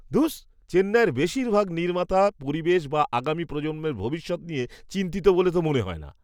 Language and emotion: Bengali, disgusted